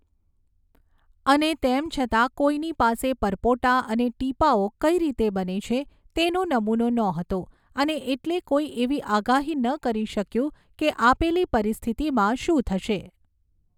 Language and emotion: Gujarati, neutral